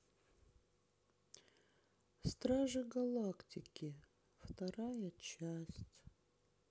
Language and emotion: Russian, sad